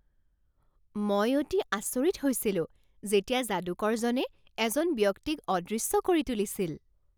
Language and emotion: Assamese, surprised